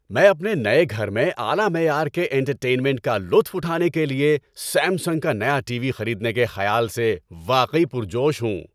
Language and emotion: Urdu, happy